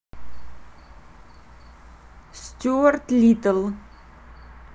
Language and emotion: Russian, neutral